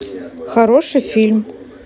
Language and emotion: Russian, neutral